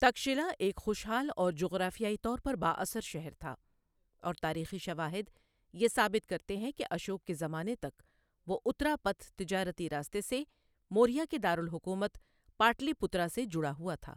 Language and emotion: Urdu, neutral